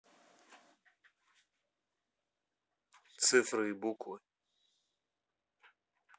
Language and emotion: Russian, neutral